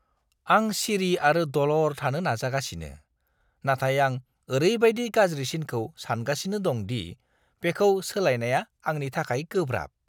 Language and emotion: Bodo, disgusted